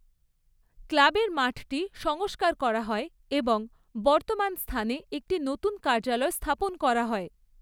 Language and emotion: Bengali, neutral